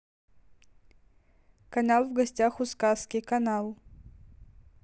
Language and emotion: Russian, neutral